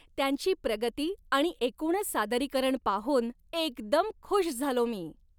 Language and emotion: Marathi, happy